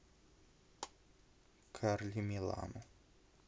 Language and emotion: Russian, neutral